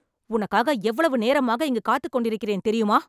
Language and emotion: Tamil, angry